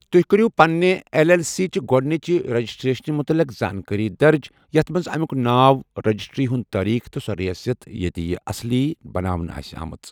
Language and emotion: Kashmiri, neutral